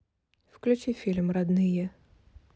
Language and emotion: Russian, neutral